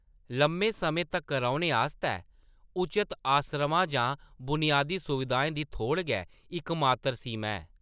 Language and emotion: Dogri, neutral